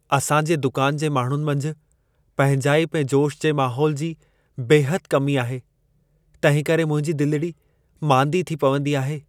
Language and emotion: Sindhi, sad